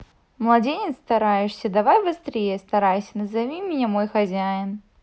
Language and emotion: Russian, neutral